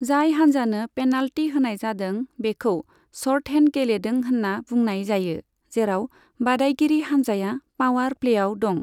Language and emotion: Bodo, neutral